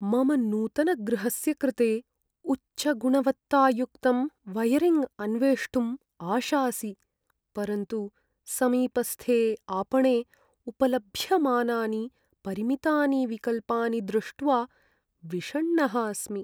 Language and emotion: Sanskrit, sad